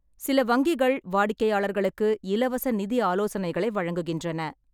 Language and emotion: Tamil, neutral